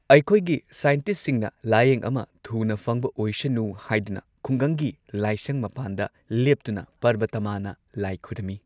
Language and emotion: Manipuri, neutral